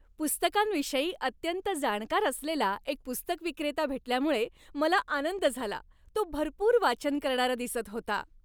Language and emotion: Marathi, happy